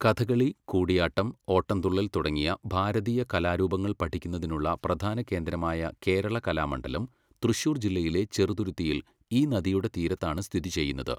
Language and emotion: Malayalam, neutral